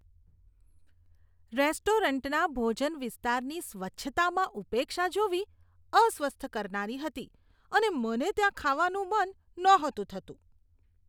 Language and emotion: Gujarati, disgusted